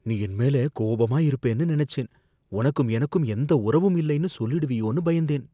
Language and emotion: Tamil, fearful